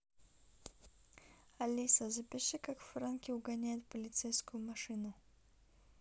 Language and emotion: Russian, neutral